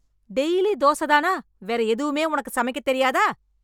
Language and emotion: Tamil, angry